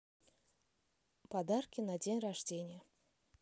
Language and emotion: Russian, neutral